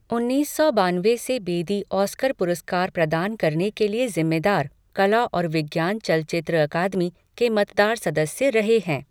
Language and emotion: Hindi, neutral